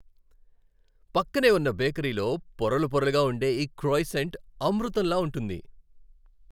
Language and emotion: Telugu, happy